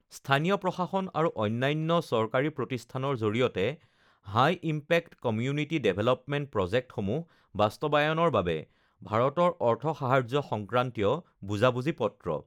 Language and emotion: Assamese, neutral